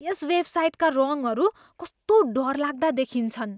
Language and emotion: Nepali, disgusted